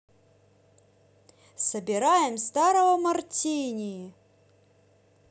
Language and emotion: Russian, positive